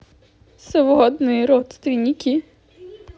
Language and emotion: Russian, sad